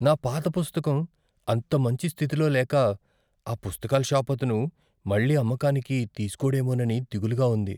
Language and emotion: Telugu, fearful